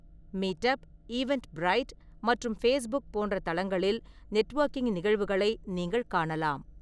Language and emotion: Tamil, neutral